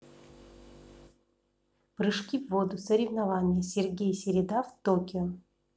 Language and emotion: Russian, neutral